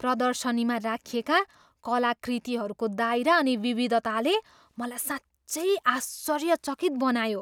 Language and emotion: Nepali, surprised